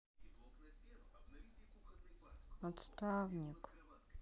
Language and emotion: Russian, sad